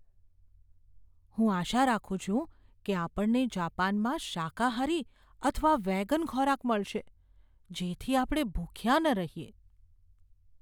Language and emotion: Gujarati, fearful